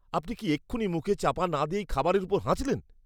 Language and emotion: Bengali, disgusted